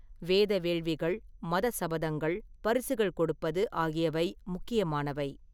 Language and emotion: Tamil, neutral